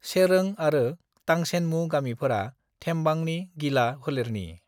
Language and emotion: Bodo, neutral